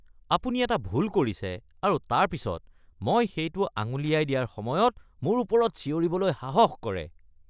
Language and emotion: Assamese, disgusted